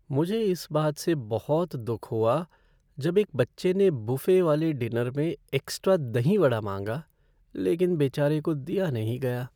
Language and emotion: Hindi, sad